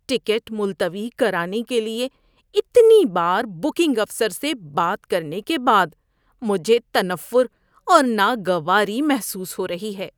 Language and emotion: Urdu, disgusted